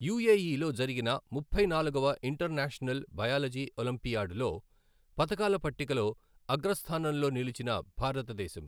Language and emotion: Telugu, neutral